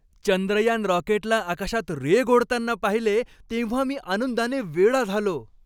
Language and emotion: Marathi, happy